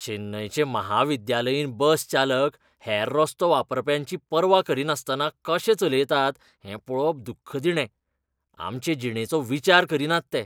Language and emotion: Goan Konkani, disgusted